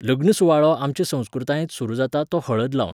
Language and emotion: Goan Konkani, neutral